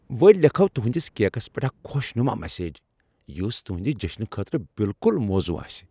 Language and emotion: Kashmiri, happy